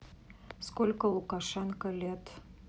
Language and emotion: Russian, neutral